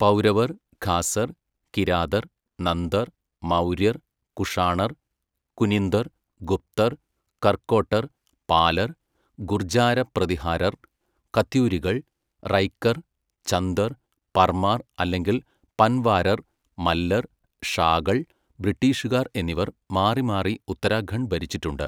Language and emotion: Malayalam, neutral